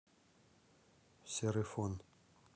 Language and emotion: Russian, neutral